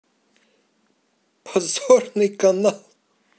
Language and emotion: Russian, positive